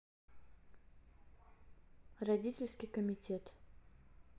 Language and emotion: Russian, neutral